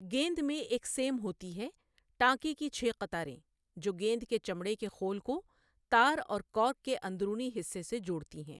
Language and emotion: Urdu, neutral